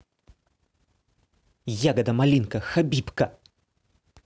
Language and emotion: Russian, angry